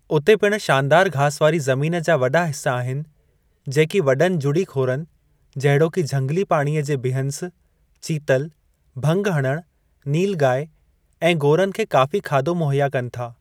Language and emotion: Sindhi, neutral